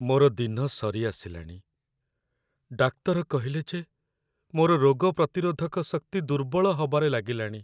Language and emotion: Odia, sad